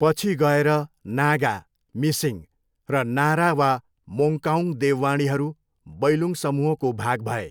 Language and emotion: Nepali, neutral